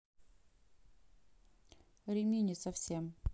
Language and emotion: Russian, neutral